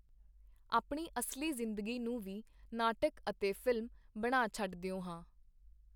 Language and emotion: Punjabi, neutral